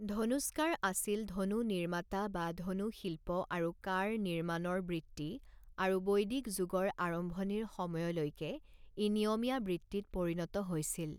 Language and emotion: Assamese, neutral